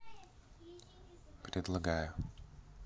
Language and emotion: Russian, neutral